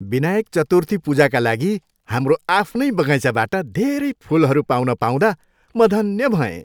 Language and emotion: Nepali, happy